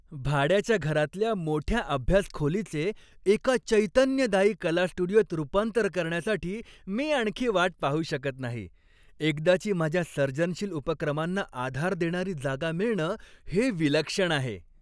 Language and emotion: Marathi, happy